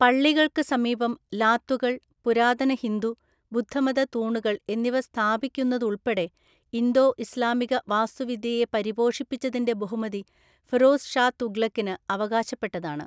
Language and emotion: Malayalam, neutral